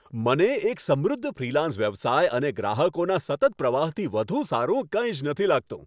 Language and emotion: Gujarati, happy